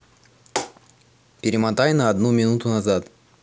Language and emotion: Russian, neutral